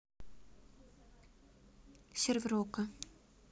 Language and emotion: Russian, neutral